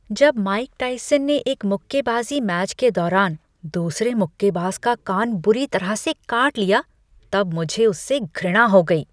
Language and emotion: Hindi, disgusted